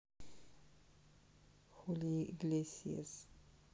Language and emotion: Russian, neutral